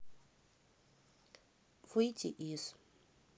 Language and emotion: Russian, neutral